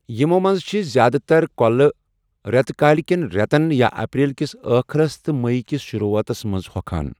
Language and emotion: Kashmiri, neutral